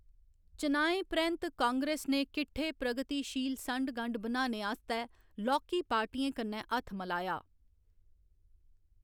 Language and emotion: Dogri, neutral